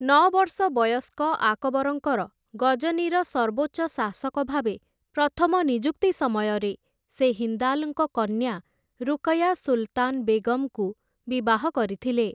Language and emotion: Odia, neutral